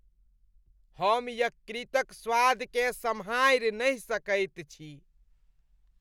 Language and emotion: Maithili, disgusted